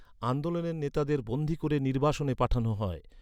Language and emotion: Bengali, neutral